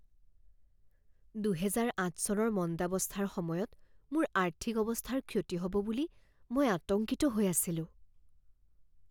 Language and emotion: Assamese, fearful